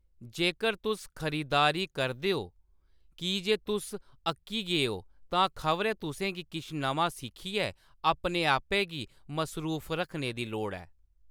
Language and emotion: Dogri, neutral